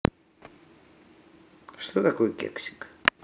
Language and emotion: Russian, neutral